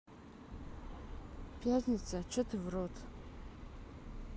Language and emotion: Russian, neutral